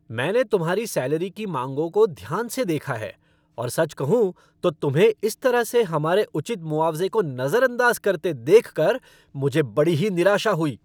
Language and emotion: Hindi, angry